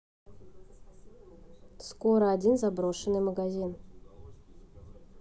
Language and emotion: Russian, neutral